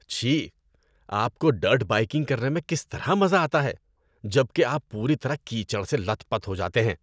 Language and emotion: Urdu, disgusted